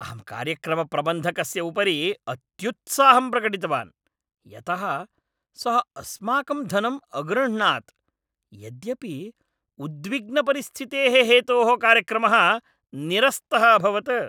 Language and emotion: Sanskrit, angry